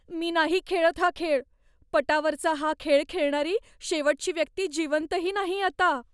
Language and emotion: Marathi, fearful